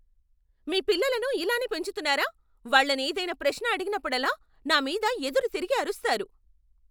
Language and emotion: Telugu, angry